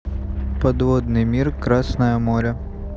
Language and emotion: Russian, neutral